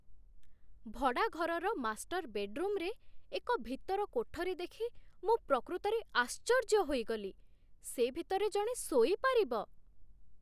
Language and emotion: Odia, surprised